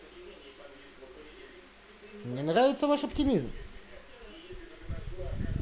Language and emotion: Russian, positive